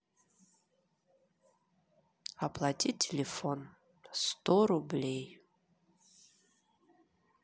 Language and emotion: Russian, neutral